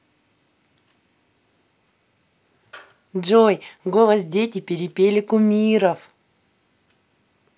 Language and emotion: Russian, positive